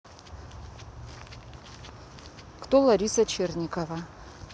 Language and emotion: Russian, neutral